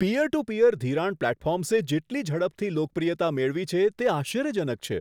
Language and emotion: Gujarati, surprised